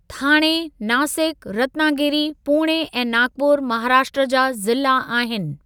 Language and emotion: Sindhi, neutral